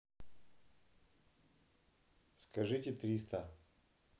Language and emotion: Russian, neutral